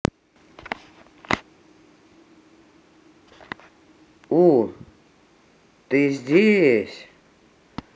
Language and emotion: Russian, positive